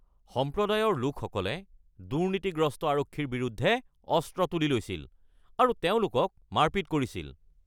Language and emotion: Assamese, angry